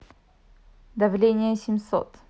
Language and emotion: Russian, neutral